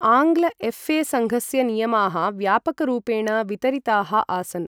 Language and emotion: Sanskrit, neutral